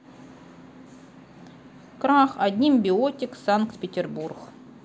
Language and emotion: Russian, neutral